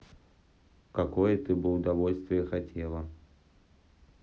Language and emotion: Russian, neutral